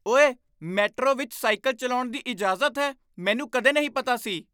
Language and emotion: Punjabi, surprised